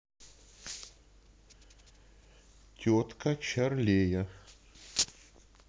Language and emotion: Russian, neutral